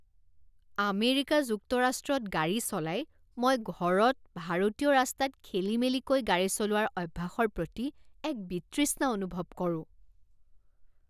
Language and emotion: Assamese, disgusted